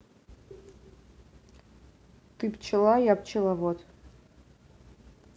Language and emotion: Russian, neutral